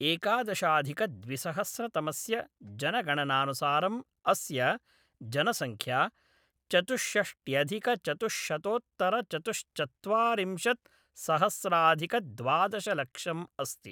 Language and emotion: Sanskrit, neutral